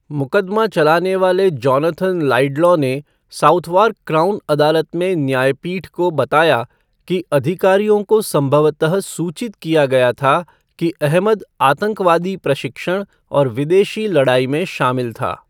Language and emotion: Hindi, neutral